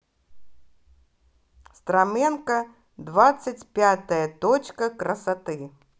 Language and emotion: Russian, positive